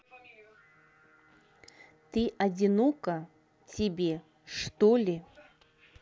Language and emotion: Russian, neutral